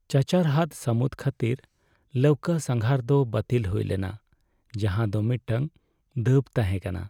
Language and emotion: Santali, sad